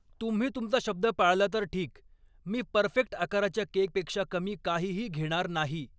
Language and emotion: Marathi, angry